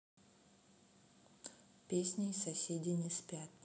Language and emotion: Russian, neutral